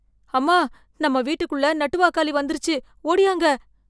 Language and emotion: Tamil, fearful